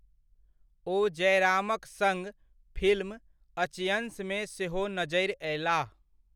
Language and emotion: Maithili, neutral